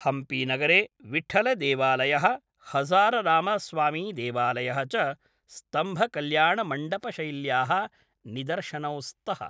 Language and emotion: Sanskrit, neutral